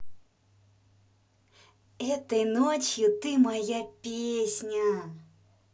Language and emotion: Russian, positive